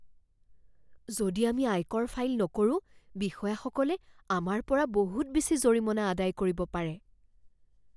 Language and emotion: Assamese, fearful